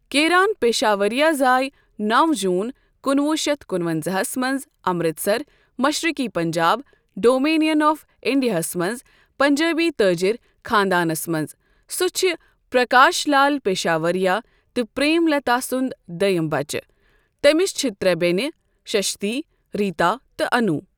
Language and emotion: Kashmiri, neutral